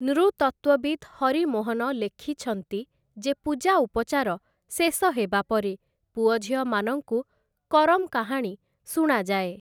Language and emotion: Odia, neutral